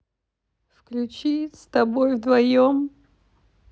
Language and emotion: Russian, sad